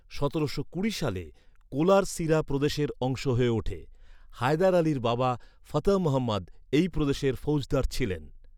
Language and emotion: Bengali, neutral